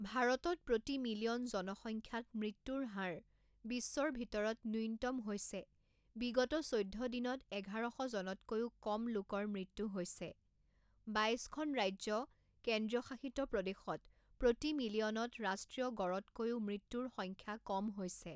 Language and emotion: Assamese, neutral